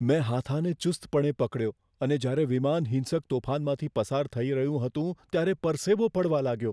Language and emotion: Gujarati, fearful